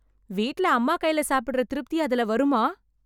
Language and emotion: Tamil, happy